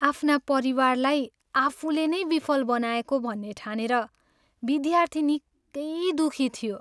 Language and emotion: Nepali, sad